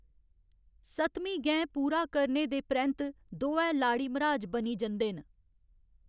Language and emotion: Dogri, neutral